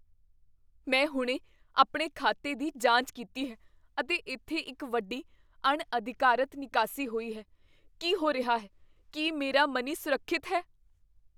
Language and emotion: Punjabi, fearful